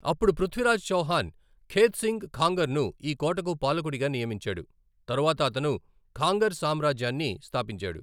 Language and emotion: Telugu, neutral